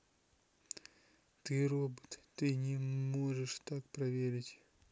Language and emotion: Russian, neutral